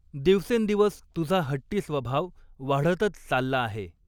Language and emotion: Marathi, neutral